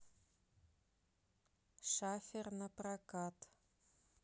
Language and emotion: Russian, neutral